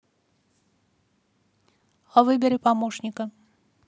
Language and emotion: Russian, neutral